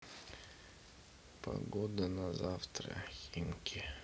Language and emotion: Russian, sad